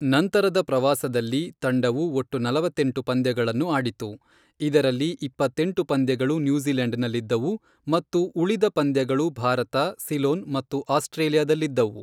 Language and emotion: Kannada, neutral